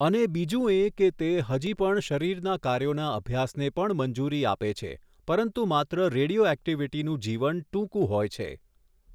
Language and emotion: Gujarati, neutral